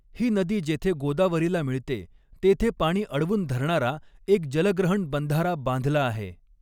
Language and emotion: Marathi, neutral